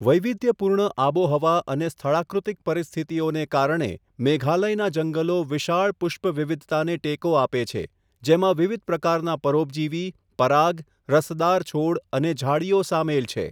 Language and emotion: Gujarati, neutral